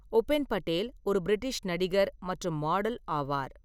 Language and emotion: Tamil, neutral